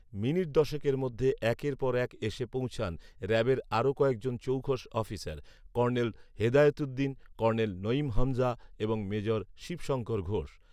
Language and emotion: Bengali, neutral